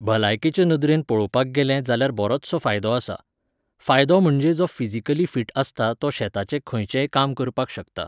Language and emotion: Goan Konkani, neutral